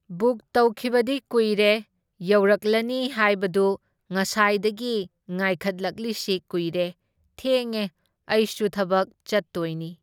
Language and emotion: Manipuri, neutral